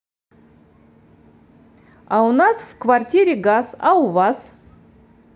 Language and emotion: Russian, positive